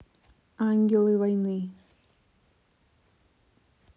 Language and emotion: Russian, neutral